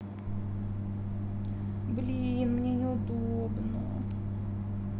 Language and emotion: Russian, sad